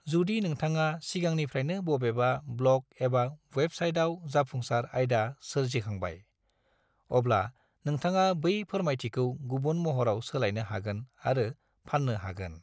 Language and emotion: Bodo, neutral